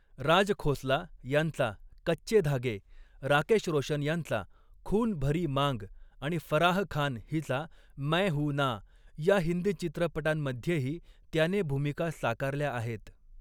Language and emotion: Marathi, neutral